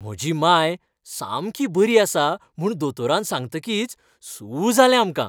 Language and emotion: Goan Konkani, happy